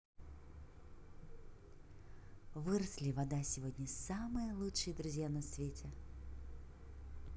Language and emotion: Russian, positive